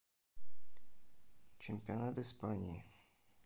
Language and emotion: Russian, neutral